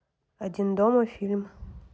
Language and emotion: Russian, neutral